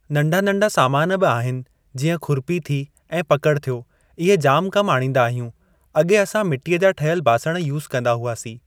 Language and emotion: Sindhi, neutral